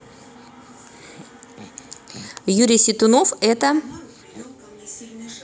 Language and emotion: Russian, neutral